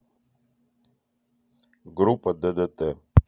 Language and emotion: Russian, neutral